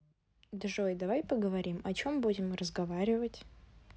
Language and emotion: Russian, neutral